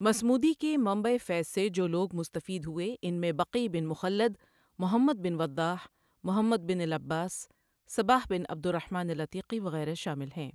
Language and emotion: Urdu, neutral